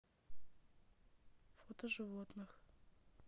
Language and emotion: Russian, neutral